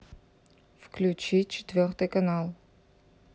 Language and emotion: Russian, neutral